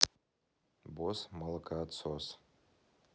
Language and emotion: Russian, neutral